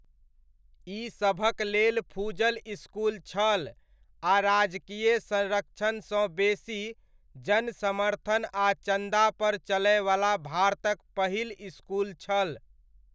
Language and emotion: Maithili, neutral